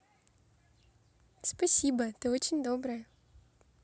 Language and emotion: Russian, positive